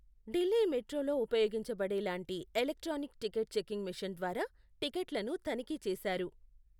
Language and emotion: Telugu, neutral